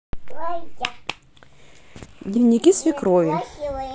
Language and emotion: Russian, neutral